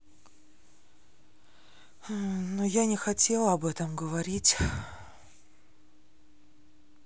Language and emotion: Russian, sad